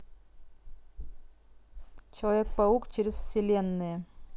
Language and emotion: Russian, neutral